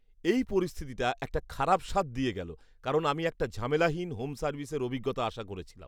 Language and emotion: Bengali, disgusted